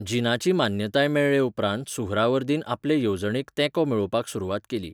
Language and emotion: Goan Konkani, neutral